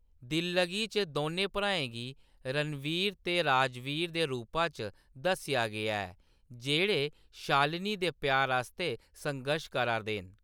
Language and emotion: Dogri, neutral